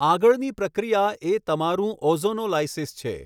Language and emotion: Gujarati, neutral